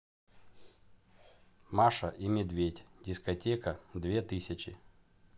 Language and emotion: Russian, neutral